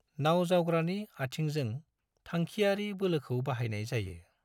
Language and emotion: Bodo, neutral